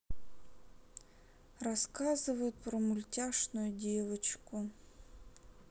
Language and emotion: Russian, sad